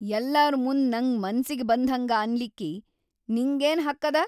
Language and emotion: Kannada, angry